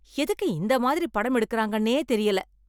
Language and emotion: Tamil, angry